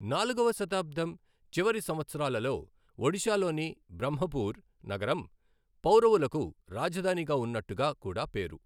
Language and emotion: Telugu, neutral